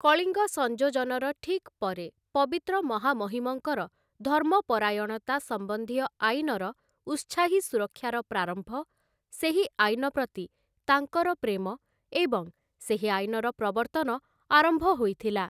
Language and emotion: Odia, neutral